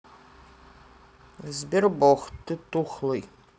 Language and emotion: Russian, neutral